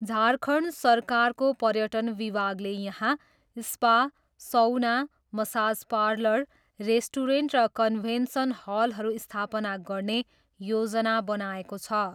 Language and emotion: Nepali, neutral